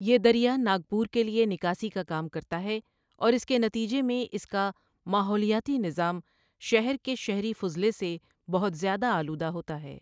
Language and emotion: Urdu, neutral